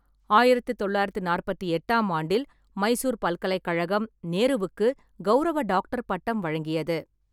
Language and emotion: Tamil, neutral